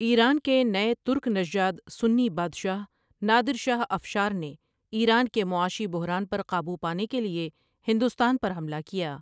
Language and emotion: Urdu, neutral